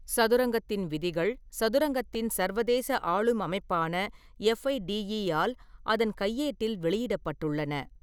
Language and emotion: Tamil, neutral